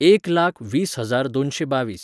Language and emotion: Goan Konkani, neutral